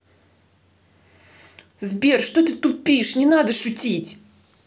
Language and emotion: Russian, angry